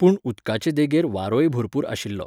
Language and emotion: Goan Konkani, neutral